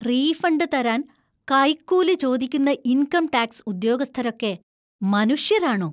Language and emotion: Malayalam, disgusted